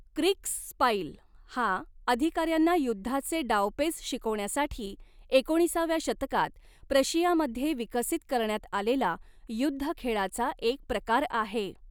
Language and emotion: Marathi, neutral